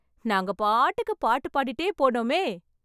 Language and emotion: Tamil, happy